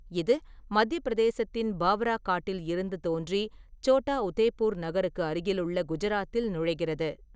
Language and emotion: Tamil, neutral